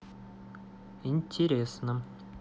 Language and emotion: Russian, neutral